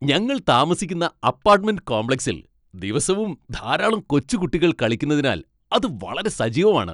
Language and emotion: Malayalam, happy